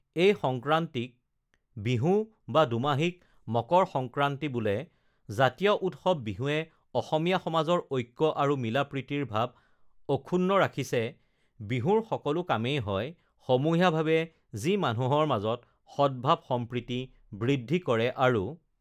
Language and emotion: Assamese, neutral